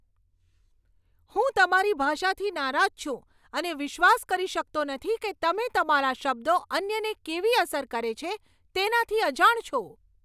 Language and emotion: Gujarati, angry